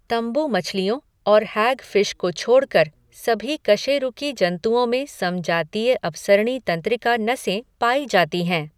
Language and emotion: Hindi, neutral